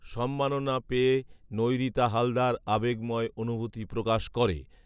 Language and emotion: Bengali, neutral